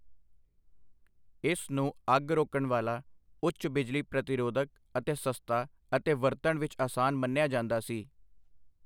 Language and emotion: Punjabi, neutral